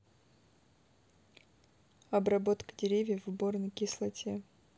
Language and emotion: Russian, neutral